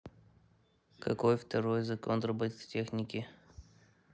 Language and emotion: Russian, neutral